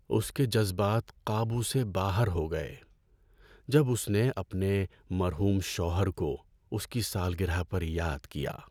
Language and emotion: Urdu, sad